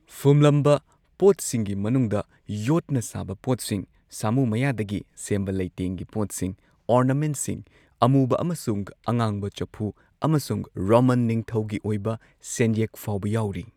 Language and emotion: Manipuri, neutral